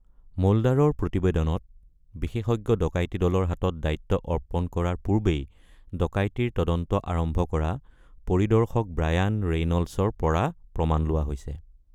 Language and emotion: Assamese, neutral